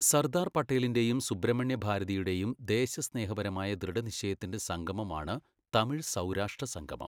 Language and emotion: Malayalam, neutral